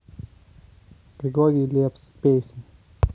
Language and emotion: Russian, neutral